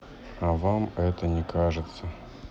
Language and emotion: Russian, sad